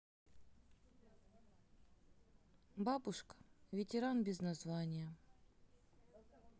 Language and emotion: Russian, neutral